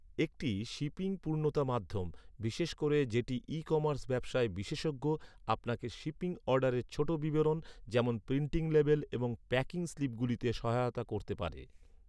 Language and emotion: Bengali, neutral